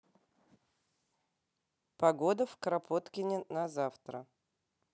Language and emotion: Russian, neutral